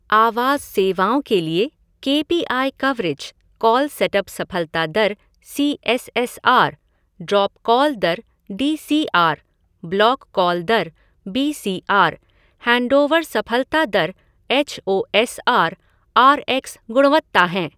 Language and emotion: Hindi, neutral